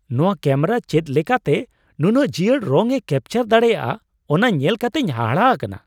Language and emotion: Santali, surprised